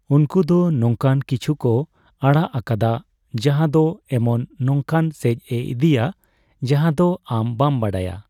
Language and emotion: Santali, neutral